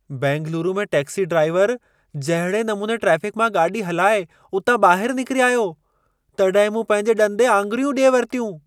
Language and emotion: Sindhi, surprised